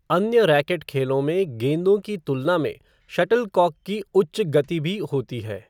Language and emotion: Hindi, neutral